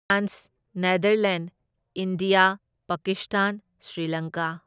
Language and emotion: Manipuri, neutral